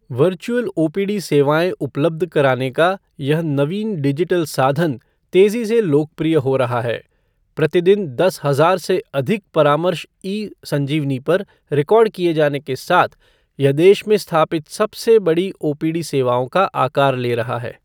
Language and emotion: Hindi, neutral